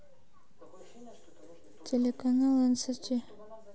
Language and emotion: Russian, neutral